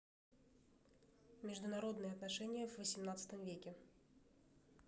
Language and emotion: Russian, neutral